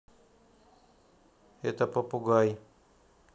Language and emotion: Russian, neutral